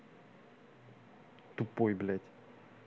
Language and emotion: Russian, angry